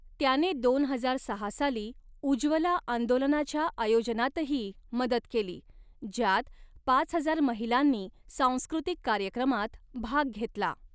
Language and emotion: Marathi, neutral